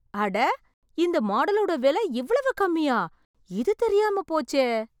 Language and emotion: Tamil, surprised